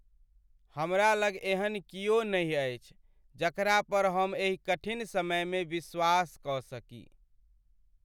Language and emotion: Maithili, sad